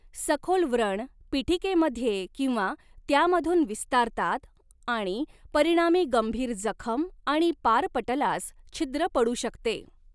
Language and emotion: Marathi, neutral